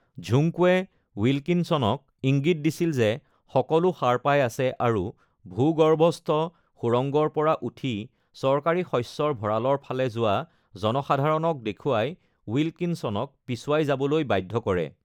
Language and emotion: Assamese, neutral